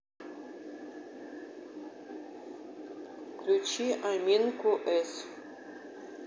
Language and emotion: Russian, neutral